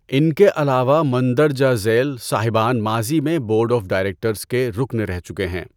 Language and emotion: Urdu, neutral